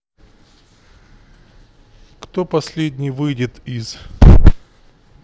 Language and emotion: Russian, neutral